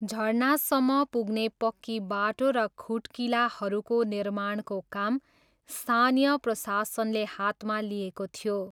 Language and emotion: Nepali, neutral